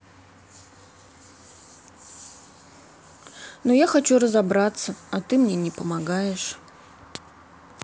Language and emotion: Russian, sad